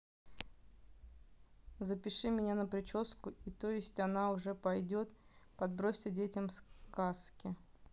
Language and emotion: Russian, neutral